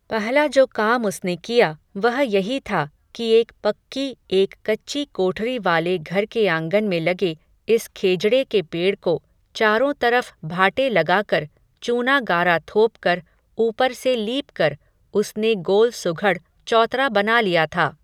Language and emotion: Hindi, neutral